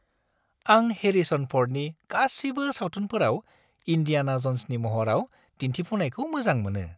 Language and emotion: Bodo, happy